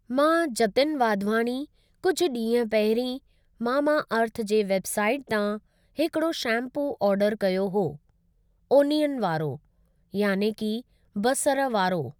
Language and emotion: Sindhi, neutral